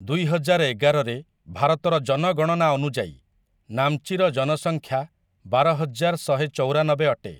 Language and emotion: Odia, neutral